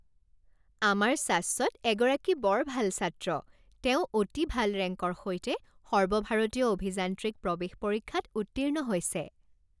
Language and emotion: Assamese, happy